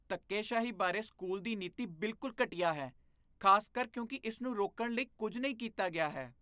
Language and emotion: Punjabi, disgusted